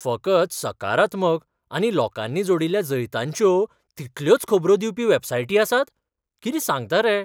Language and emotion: Goan Konkani, surprised